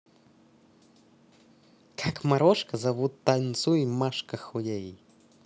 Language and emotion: Russian, positive